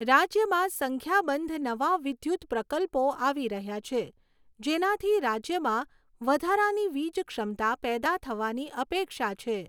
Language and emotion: Gujarati, neutral